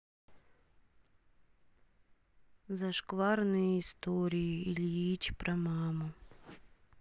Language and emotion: Russian, sad